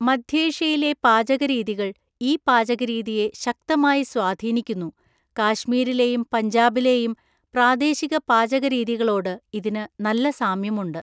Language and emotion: Malayalam, neutral